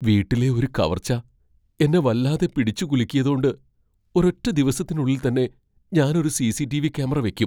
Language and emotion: Malayalam, fearful